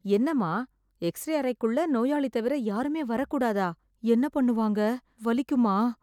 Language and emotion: Tamil, fearful